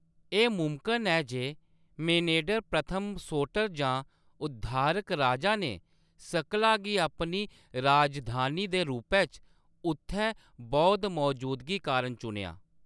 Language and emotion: Dogri, neutral